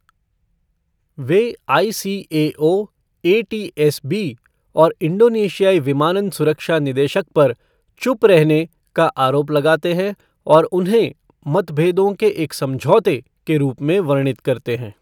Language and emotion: Hindi, neutral